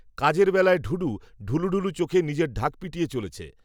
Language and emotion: Bengali, neutral